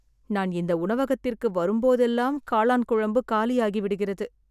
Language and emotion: Tamil, sad